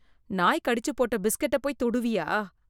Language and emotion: Tamil, disgusted